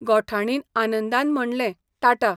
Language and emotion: Goan Konkani, neutral